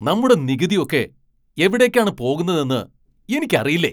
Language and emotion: Malayalam, angry